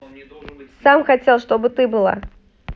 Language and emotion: Russian, neutral